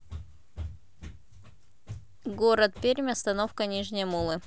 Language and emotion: Russian, neutral